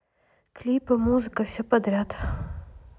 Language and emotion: Russian, neutral